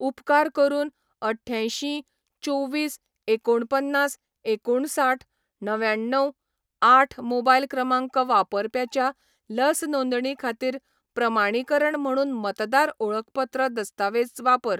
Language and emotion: Goan Konkani, neutral